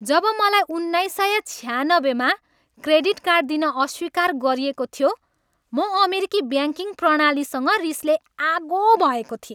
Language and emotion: Nepali, angry